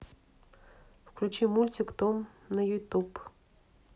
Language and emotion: Russian, neutral